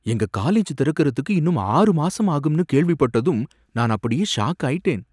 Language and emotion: Tamil, surprised